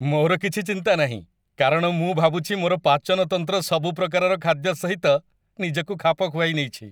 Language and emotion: Odia, happy